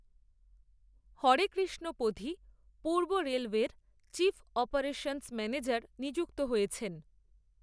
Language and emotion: Bengali, neutral